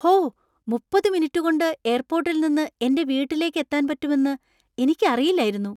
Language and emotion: Malayalam, surprised